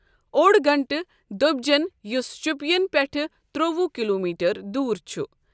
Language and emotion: Kashmiri, neutral